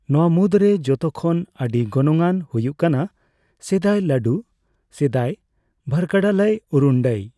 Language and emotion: Santali, neutral